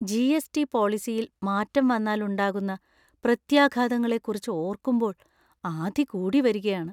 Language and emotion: Malayalam, fearful